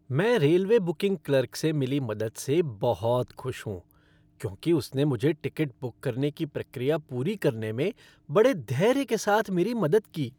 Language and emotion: Hindi, happy